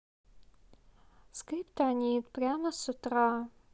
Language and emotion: Russian, neutral